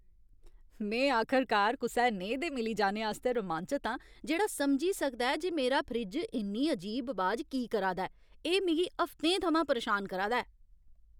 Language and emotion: Dogri, happy